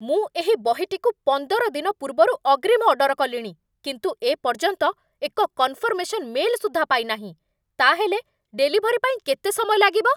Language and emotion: Odia, angry